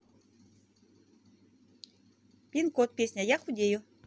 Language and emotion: Russian, positive